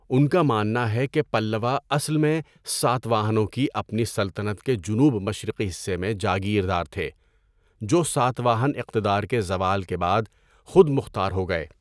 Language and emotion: Urdu, neutral